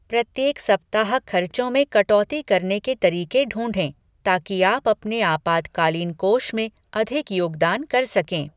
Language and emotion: Hindi, neutral